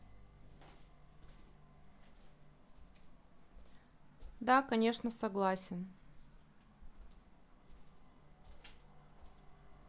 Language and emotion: Russian, neutral